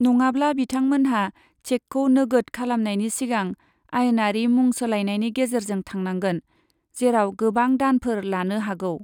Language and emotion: Bodo, neutral